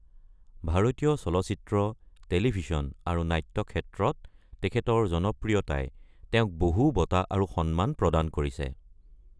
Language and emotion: Assamese, neutral